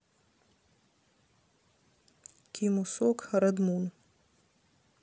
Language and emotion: Russian, neutral